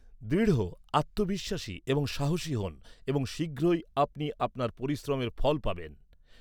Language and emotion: Bengali, neutral